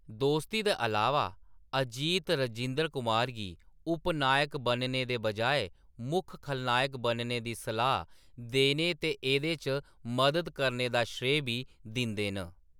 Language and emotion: Dogri, neutral